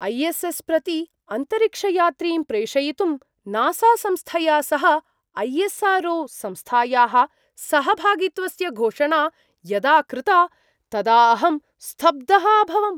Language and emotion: Sanskrit, surprised